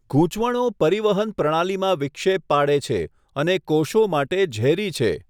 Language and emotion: Gujarati, neutral